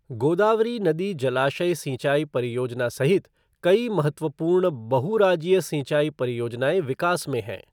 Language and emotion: Hindi, neutral